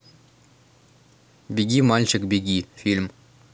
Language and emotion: Russian, neutral